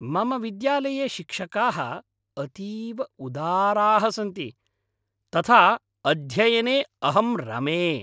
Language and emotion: Sanskrit, happy